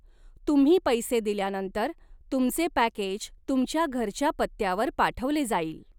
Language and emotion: Marathi, neutral